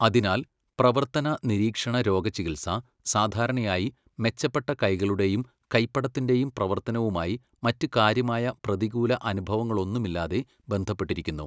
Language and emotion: Malayalam, neutral